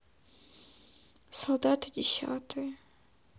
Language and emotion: Russian, sad